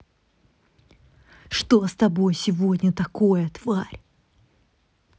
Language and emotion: Russian, angry